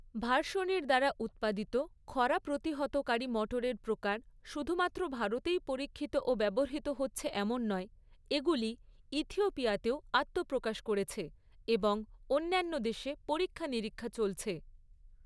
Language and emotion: Bengali, neutral